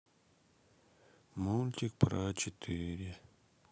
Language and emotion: Russian, sad